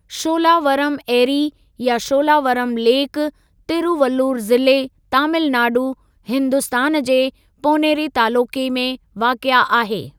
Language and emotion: Sindhi, neutral